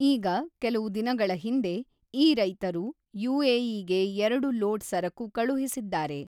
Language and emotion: Kannada, neutral